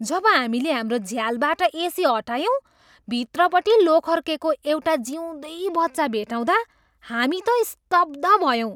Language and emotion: Nepali, surprised